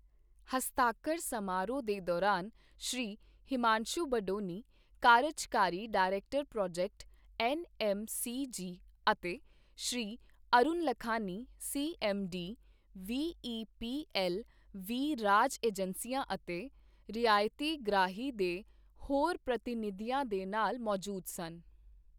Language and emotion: Punjabi, neutral